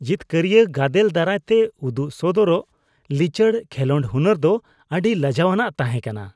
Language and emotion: Santali, disgusted